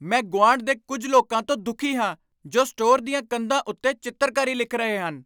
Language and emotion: Punjabi, angry